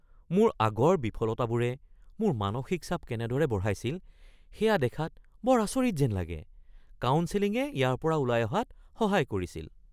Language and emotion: Assamese, surprised